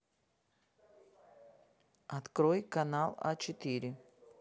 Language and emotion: Russian, neutral